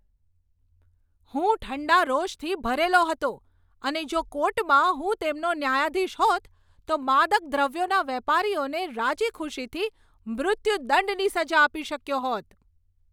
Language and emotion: Gujarati, angry